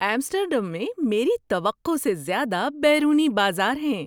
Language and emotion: Urdu, surprised